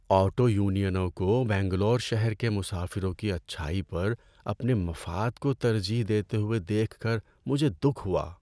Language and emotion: Urdu, sad